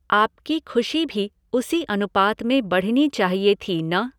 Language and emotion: Hindi, neutral